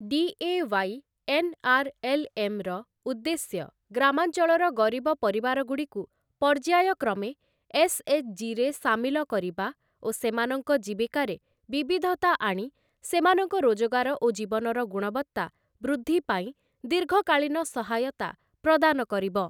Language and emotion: Odia, neutral